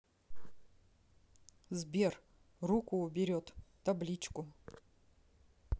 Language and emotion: Russian, neutral